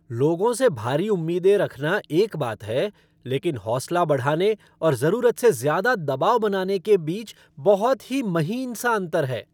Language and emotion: Hindi, angry